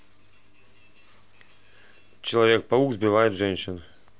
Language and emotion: Russian, neutral